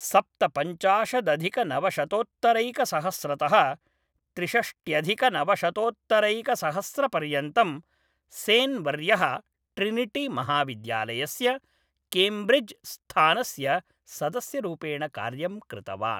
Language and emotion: Sanskrit, neutral